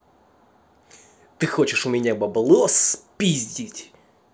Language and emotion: Russian, angry